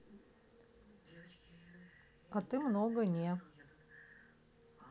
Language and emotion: Russian, neutral